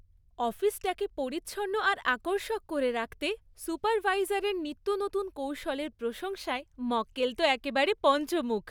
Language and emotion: Bengali, happy